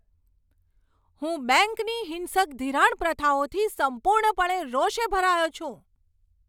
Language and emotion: Gujarati, angry